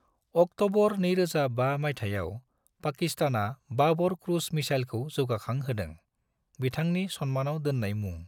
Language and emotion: Bodo, neutral